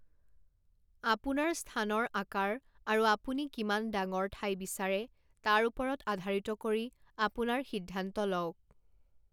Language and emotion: Assamese, neutral